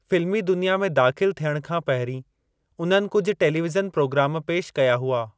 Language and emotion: Sindhi, neutral